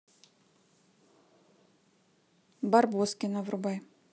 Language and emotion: Russian, neutral